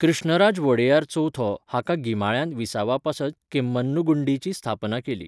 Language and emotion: Goan Konkani, neutral